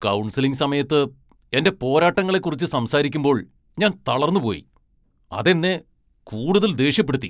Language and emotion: Malayalam, angry